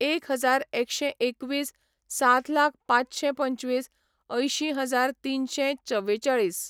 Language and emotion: Goan Konkani, neutral